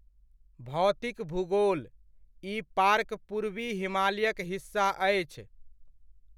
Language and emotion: Maithili, neutral